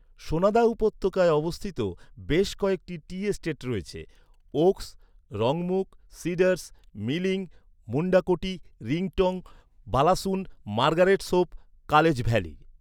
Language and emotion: Bengali, neutral